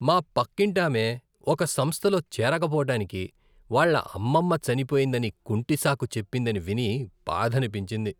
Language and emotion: Telugu, disgusted